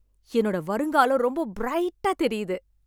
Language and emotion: Tamil, happy